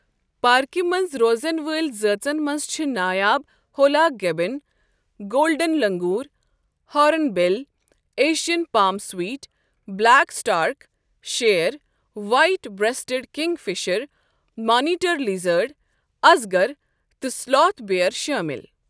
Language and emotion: Kashmiri, neutral